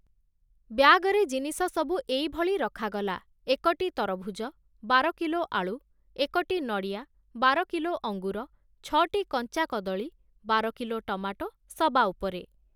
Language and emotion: Odia, neutral